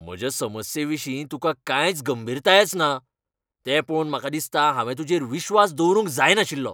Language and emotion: Goan Konkani, angry